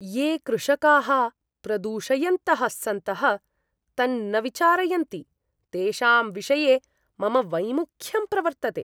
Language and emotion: Sanskrit, disgusted